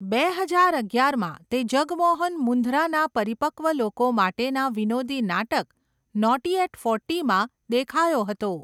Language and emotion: Gujarati, neutral